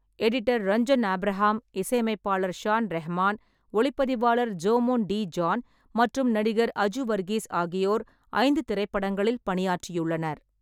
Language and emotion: Tamil, neutral